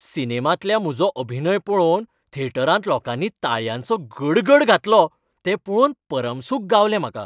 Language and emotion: Goan Konkani, happy